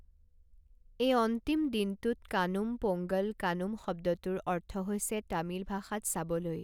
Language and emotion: Assamese, neutral